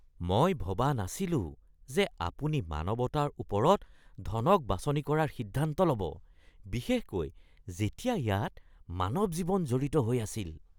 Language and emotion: Assamese, disgusted